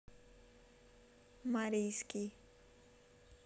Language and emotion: Russian, neutral